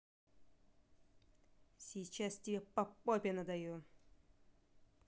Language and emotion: Russian, angry